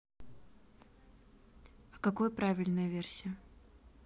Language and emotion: Russian, neutral